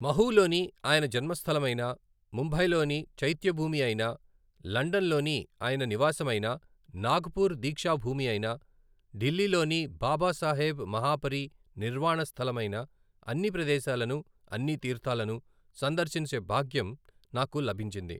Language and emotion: Telugu, neutral